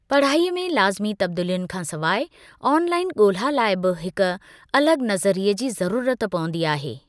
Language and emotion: Sindhi, neutral